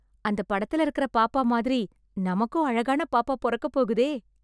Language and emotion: Tamil, happy